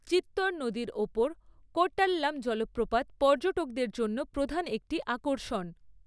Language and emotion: Bengali, neutral